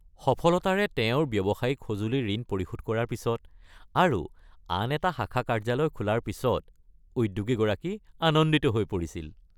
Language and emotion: Assamese, happy